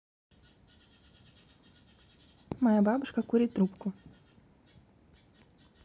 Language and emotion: Russian, neutral